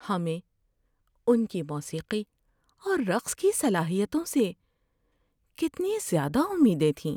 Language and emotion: Urdu, sad